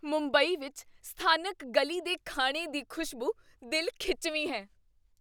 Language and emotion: Punjabi, surprised